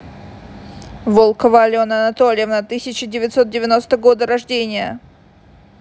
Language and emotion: Russian, angry